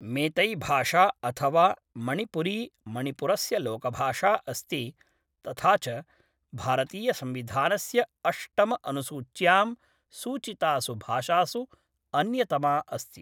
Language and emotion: Sanskrit, neutral